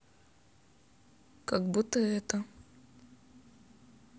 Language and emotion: Russian, sad